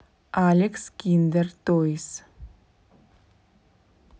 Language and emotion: Russian, neutral